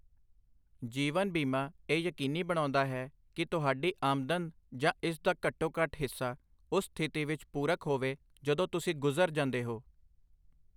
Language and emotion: Punjabi, neutral